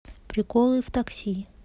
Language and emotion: Russian, neutral